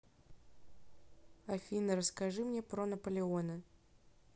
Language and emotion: Russian, neutral